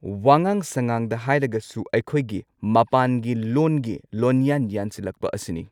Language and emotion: Manipuri, neutral